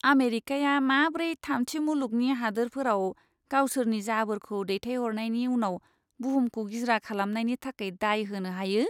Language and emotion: Bodo, disgusted